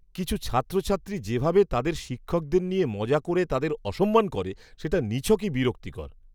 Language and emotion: Bengali, disgusted